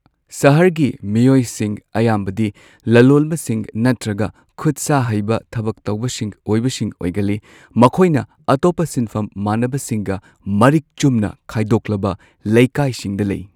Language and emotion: Manipuri, neutral